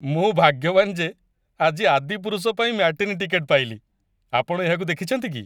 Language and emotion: Odia, happy